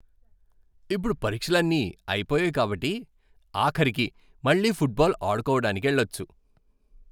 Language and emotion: Telugu, happy